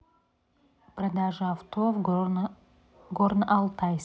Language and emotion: Russian, neutral